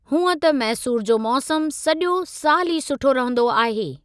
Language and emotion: Sindhi, neutral